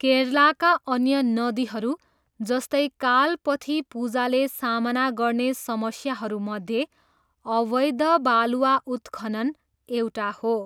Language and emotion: Nepali, neutral